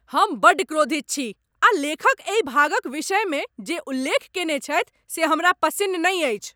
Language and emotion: Maithili, angry